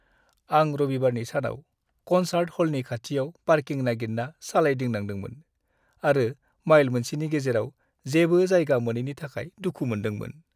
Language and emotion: Bodo, sad